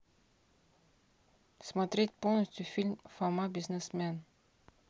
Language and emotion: Russian, neutral